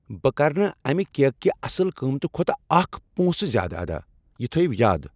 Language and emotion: Kashmiri, angry